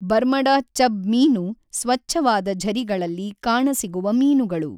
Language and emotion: Kannada, neutral